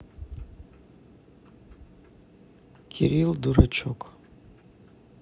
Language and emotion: Russian, neutral